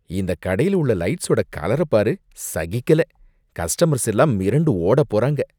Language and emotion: Tamil, disgusted